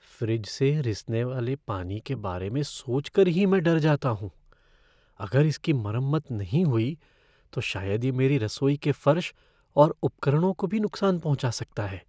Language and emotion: Hindi, fearful